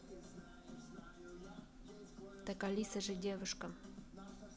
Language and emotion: Russian, neutral